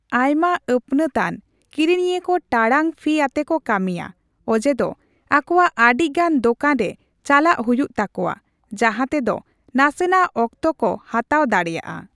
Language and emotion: Santali, neutral